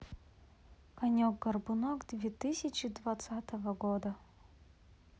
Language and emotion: Russian, sad